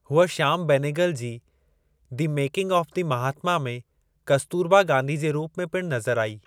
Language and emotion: Sindhi, neutral